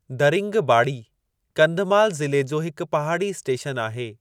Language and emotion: Sindhi, neutral